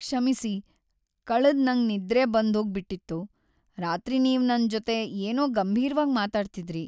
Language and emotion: Kannada, sad